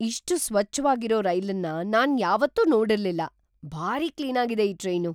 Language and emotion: Kannada, surprised